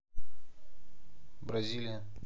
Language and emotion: Russian, neutral